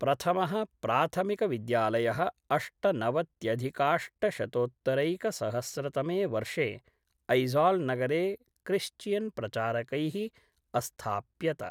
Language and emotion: Sanskrit, neutral